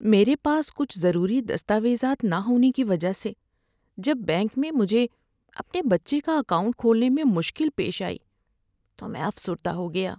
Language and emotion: Urdu, sad